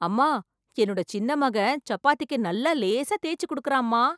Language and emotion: Tamil, surprised